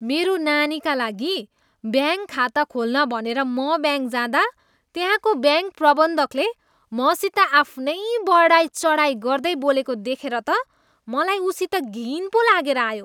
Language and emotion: Nepali, disgusted